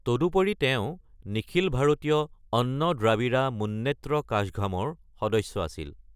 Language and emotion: Assamese, neutral